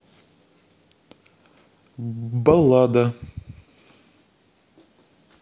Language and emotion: Russian, neutral